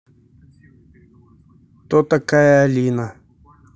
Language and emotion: Russian, neutral